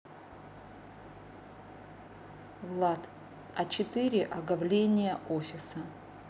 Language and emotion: Russian, neutral